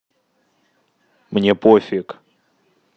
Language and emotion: Russian, neutral